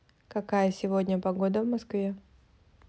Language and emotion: Russian, neutral